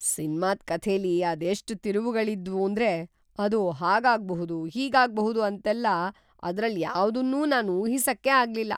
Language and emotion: Kannada, surprised